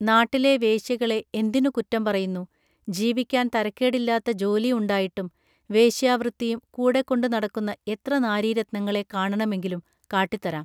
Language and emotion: Malayalam, neutral